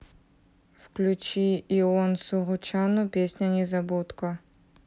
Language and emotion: Russian, neutral